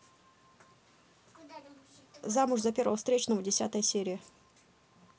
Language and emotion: Russian, neutral